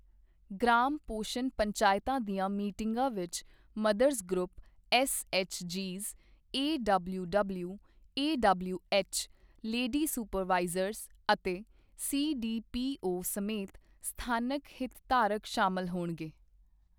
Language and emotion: Punjabi, neutral